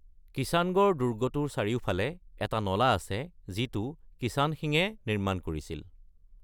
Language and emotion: Assamese, neutral